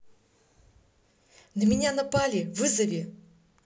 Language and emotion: Russian, neutral